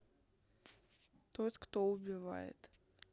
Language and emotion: Russian, neutral